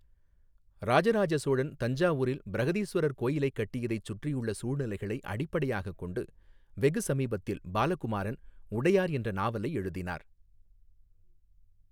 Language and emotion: Tamil, neutral